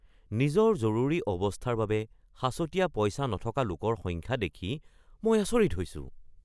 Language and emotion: Assamese, surprised